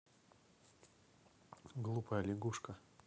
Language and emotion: Russian, neutral